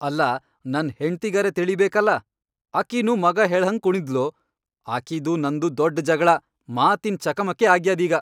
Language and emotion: Kannada, angry